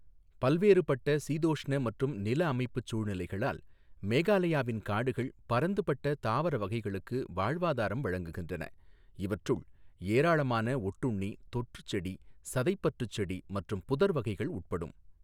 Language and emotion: Tamil, neutral